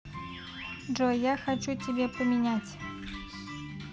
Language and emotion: Russian, neutral